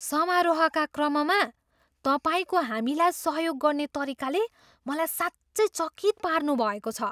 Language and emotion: Nepali, surprised